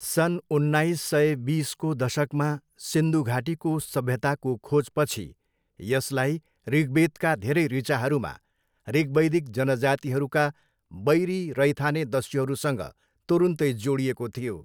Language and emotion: Nepali, neutral